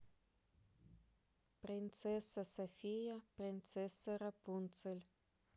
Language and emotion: Russian, neutral